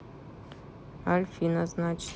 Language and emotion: Russian, neutral